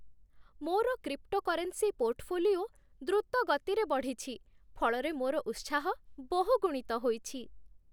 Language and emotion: Odia, happy